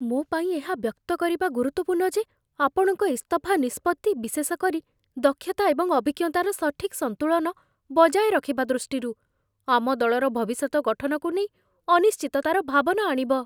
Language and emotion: Odia, fearful